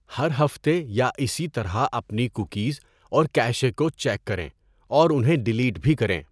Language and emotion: Urdu, neutral